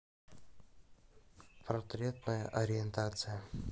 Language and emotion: Russian, neutral